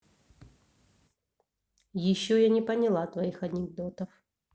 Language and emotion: Russian, neutral